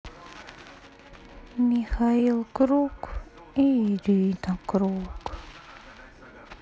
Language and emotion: Russian, sad